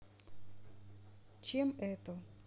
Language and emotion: Russian, neutral